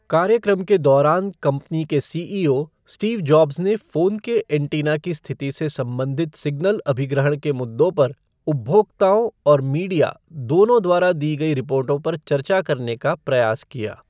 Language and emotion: Hindi, neutral